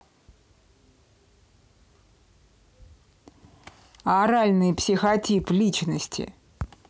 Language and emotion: Russian, angry